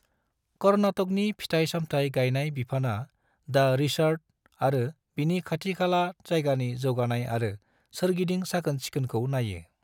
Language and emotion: Bodo, neutral